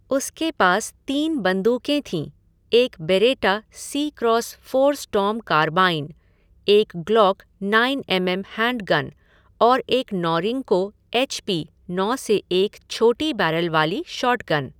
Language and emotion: Hindi, neutral